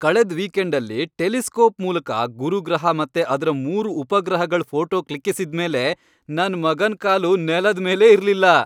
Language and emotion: Kannada, happy